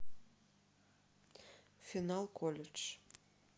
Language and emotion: Russian, neutral